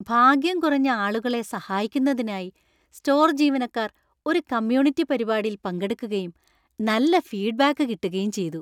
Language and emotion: Malayalam, happy